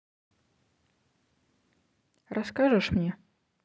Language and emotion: Russian, neutral